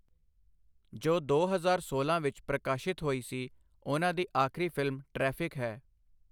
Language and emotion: Punjabi, neutral